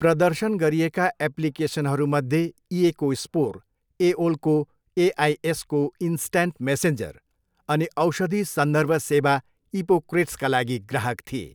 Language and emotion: Nepali, neutral